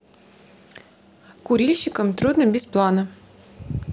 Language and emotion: Russian, neutral